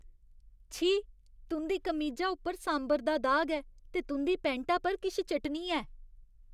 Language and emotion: Dogri, disgusted